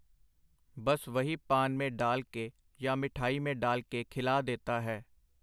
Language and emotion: Punjabi, neutral